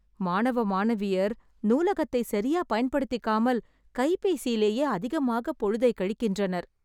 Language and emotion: Tamil, sad